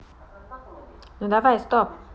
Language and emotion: Russian, neutral